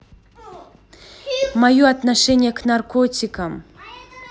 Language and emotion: Russian, neutral